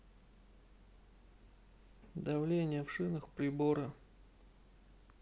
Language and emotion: Russian, neutral